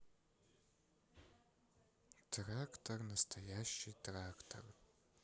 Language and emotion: Russian, sad